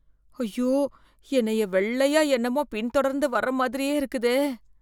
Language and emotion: Tamil, fearful